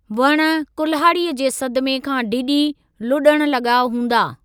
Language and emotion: Sindhi, neutral